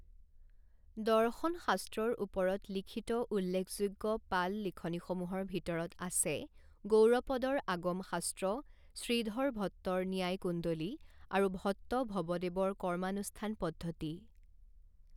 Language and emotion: Assamese, neutral